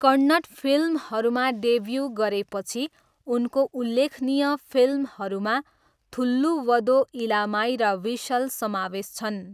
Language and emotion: Nepali, neutral